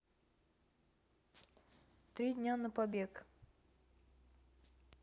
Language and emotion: Russian, neutral